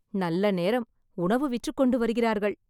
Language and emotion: Tamil, happy